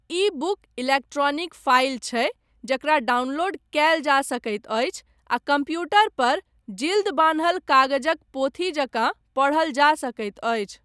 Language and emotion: Maithili, neutral